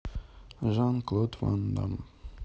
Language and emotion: Russian, neutral